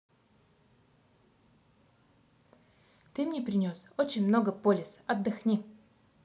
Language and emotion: Russian, positive